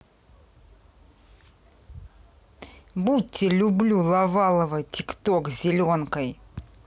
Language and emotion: Russian, angry